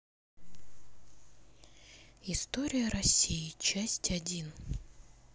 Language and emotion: Russian, sad